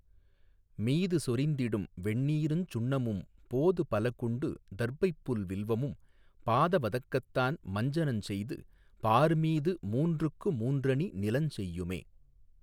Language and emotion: Tamil, neutral